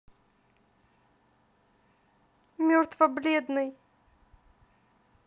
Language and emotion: Russian, sad